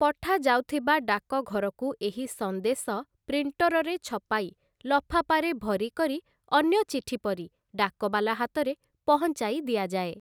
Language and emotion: Odia, neutral